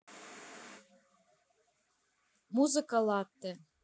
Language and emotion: Russian, neutral